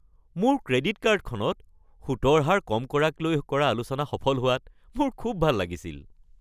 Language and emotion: Assamese, happy